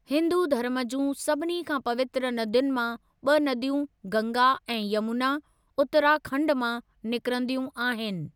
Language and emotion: Sindhi, neutral